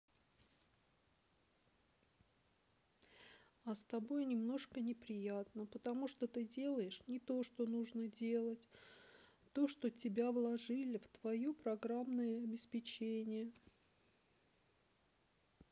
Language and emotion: Russian, sad